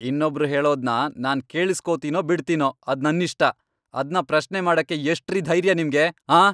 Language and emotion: Kannada, angry